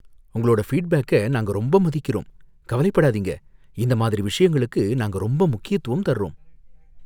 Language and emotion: Tamil, fearful